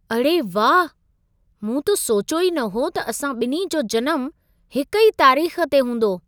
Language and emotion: Sindhi, surprised